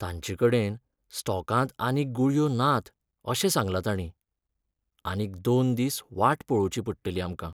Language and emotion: Goan Konkani, sad